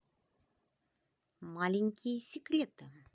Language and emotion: Russian, positive